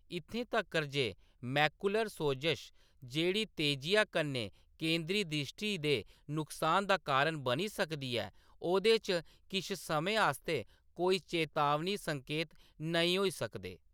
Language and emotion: Dogri, neutral